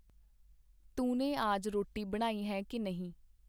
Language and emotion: Punjabi, neutral